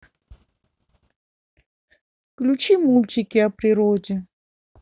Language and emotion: Russian, sad